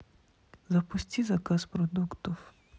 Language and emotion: Russian, sad